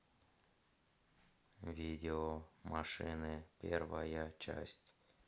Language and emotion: Russian, neutral